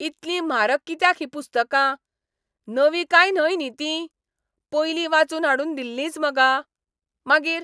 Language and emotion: Goan Konkani, angry